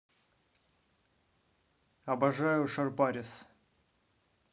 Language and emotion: Russian, positive